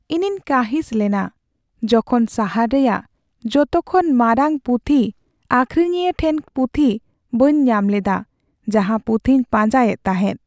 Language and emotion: Santali, sad